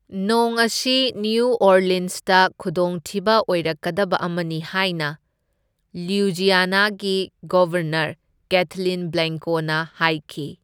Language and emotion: Manipuri, neutral